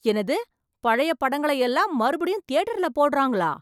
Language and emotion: Tamil, surprised